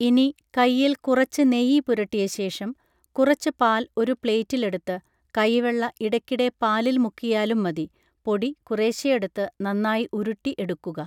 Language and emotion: Malayalam, neutral